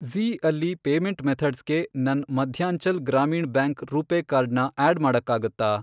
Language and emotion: Kannada, neutral